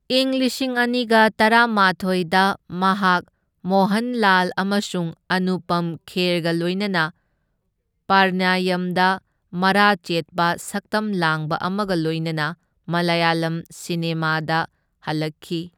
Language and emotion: Manipuri, neutral